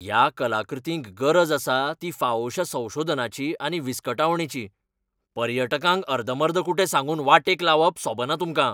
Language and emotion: Goan Konkani, angry